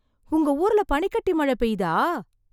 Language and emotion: Tamil, surprised